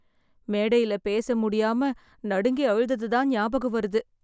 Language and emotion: Tamil, sad